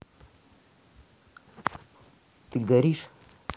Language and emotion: Russian, neutral